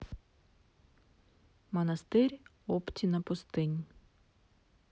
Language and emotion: Russian, neutral